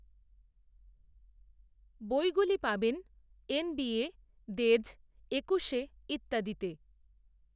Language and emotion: Bengali, neutral